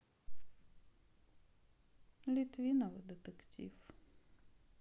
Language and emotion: Russian, sad